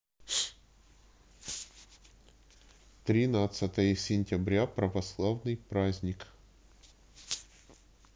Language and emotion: Russian, neutral